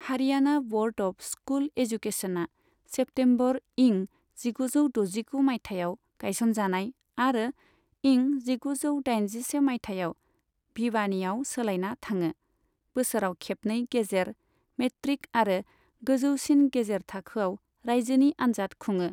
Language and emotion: Bodo, neutral